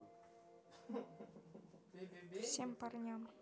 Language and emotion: Russian, neutral